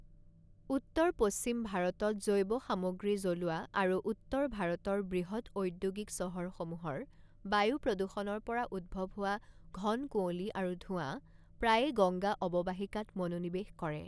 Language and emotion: Assamese, neutral